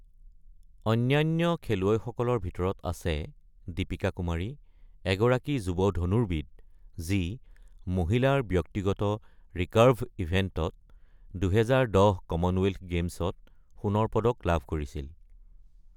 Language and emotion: Assamese, neutral